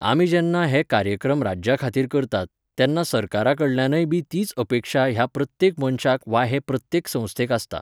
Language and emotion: Goan Konkani, neutral